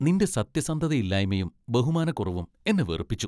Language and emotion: Malayalam, disgusted